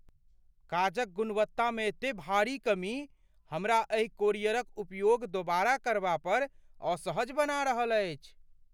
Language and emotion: Maithili, fearful